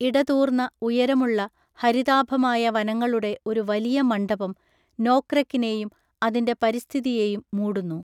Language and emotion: Malayalam, neutral